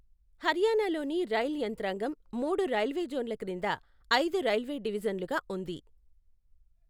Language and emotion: Telugu, neutral